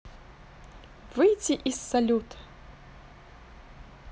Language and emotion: Russian, positive